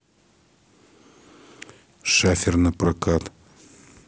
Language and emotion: Russian, neutral